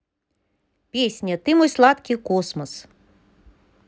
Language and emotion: Russian, neutral